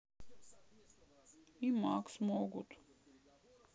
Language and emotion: Russian, sad